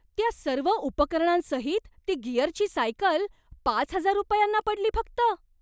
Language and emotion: Marathi, surprised